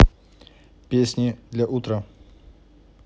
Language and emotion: Russian, neutral